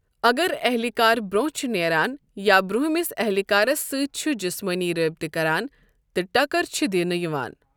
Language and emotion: Kashmiri, neutral